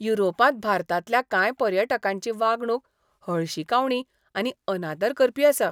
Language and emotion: Goan Konkani, disgusted